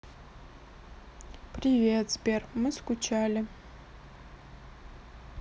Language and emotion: Russian, sad